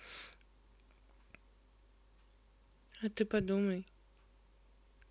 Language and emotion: Russian, neutral